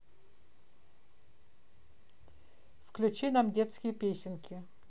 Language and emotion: Russian, neutral